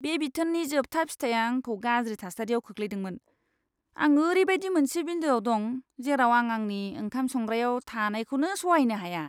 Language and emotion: Bodo, disgusted